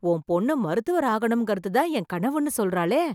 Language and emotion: Tamil, surprised